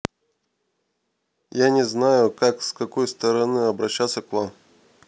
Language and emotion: Russian, neutral